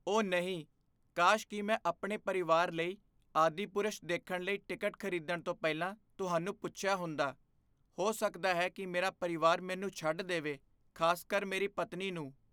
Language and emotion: Punjabi, fearful